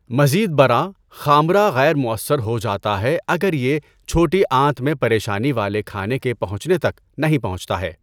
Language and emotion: Urdu, neutral